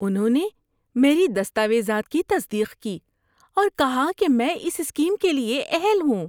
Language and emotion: Urdu, happy